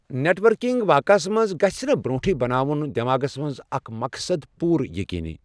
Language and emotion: Kashmiri, neutral